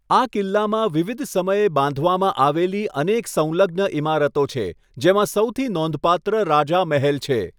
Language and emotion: Gujarati, neutral